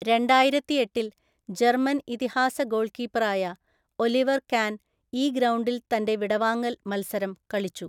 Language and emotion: Malayalam, neutral